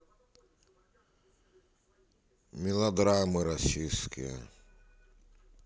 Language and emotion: Russian, neutral